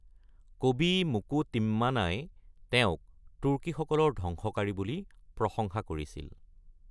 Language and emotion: Assamese, neutral